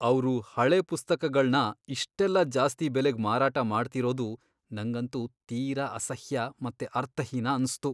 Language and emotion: Kannada, disgusted